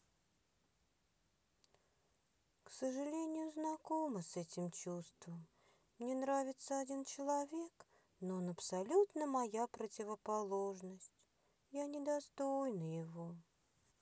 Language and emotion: Russian, sad